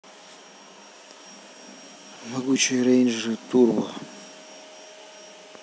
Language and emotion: Russian, sad